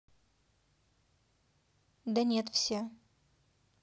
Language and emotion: Russian, neutral